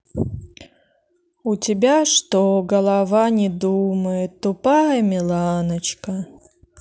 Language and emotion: Russian, neutral